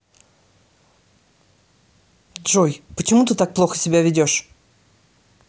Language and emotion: Russian, angry